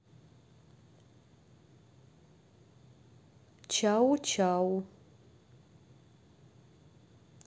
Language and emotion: Russian, neutral